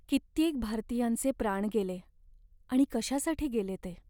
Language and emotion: Marathi, sad